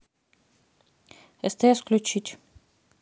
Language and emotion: Russian, neutral